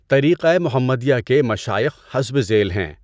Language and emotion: Urdu, neutral